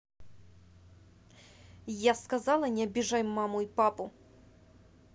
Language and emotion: Russian, angry